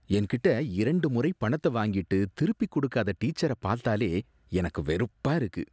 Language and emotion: Tamil, disgusted